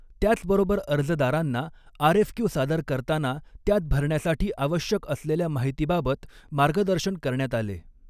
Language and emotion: Marathi, neutral